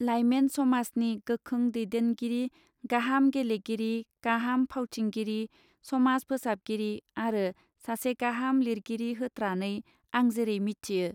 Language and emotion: Bodo, neutral